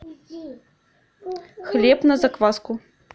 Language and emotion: Russian, neutral